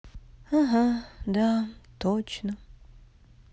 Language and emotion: Russian, sad